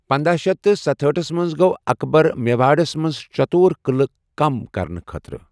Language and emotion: Kashmiri, neutral